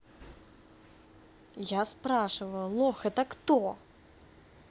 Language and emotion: Russian, angry